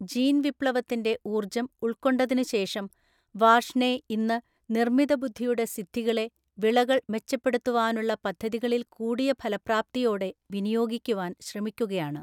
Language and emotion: Malayalam, neutral